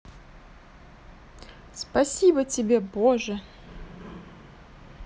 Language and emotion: Russian, positive